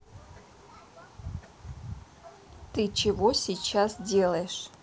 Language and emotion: Russian, neutral